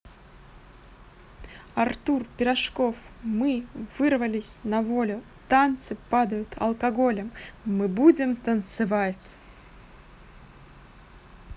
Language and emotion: Russian, positive